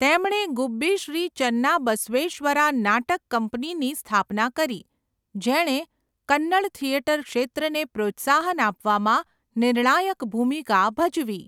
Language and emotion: Gujarati, neutral